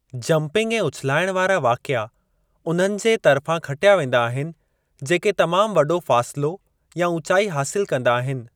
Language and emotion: Sindhi, neutral